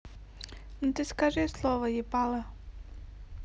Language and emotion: Russian, neutral